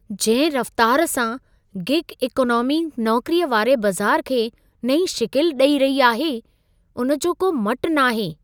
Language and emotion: Sindhi, surprised